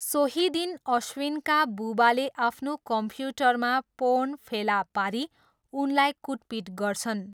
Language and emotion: Nepali, neutral